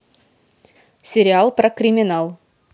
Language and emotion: Russian, neutral